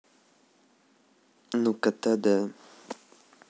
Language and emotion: Russian, neutral